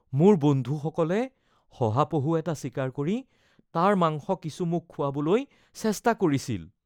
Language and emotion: Assamese, fearful